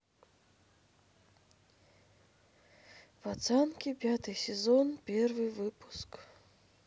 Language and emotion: Russian, sad